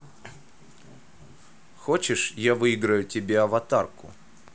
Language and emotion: Russian, neutral